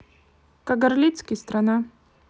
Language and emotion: Russian, neutral